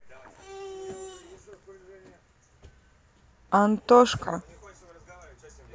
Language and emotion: Russian, neutral